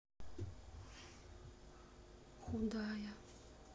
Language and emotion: Russian, sad